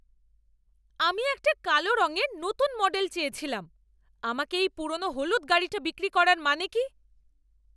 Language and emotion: Bengali, angry